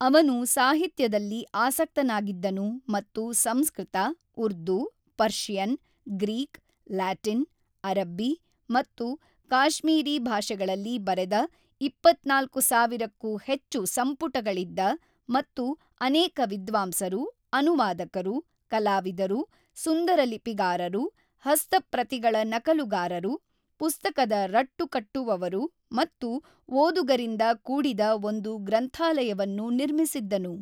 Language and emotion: Kannada, neutral